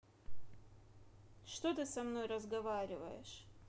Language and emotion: Russian, angry